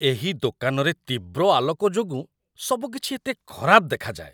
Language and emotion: Odia, disgusted